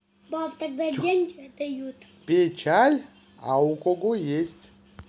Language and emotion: Russian, positive